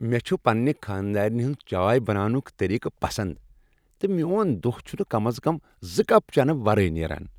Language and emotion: Kashmiri, happy